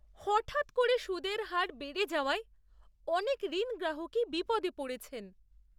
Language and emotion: Bengali, surprised